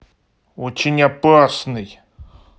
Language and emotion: Russian, angry